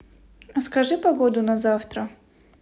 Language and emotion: Russian, neutral